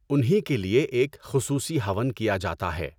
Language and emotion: Urdu, neutral